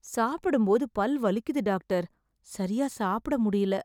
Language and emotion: Tamil, sad